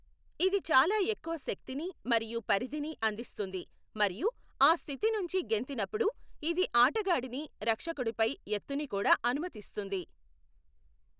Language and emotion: Telugu, neutral